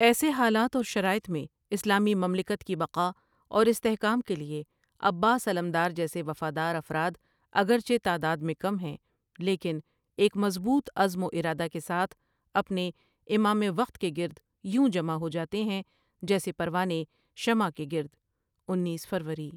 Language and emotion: Urdu, neutral